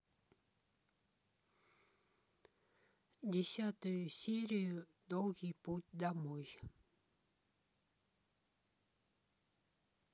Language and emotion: Russian, neutral